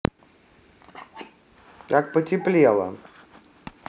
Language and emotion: Russian, neutral